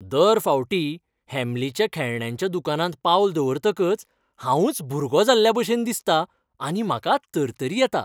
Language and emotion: Goan Konkani, happy